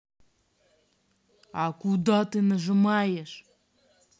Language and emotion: Russian, angry